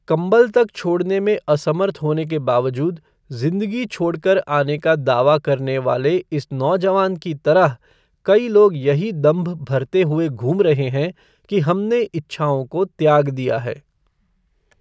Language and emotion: Hindi, neutral